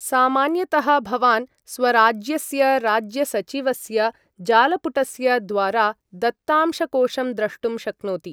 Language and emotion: Sanskrit, neutral